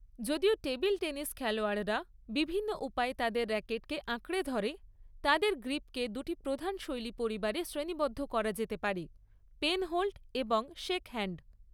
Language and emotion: Bengali, neutral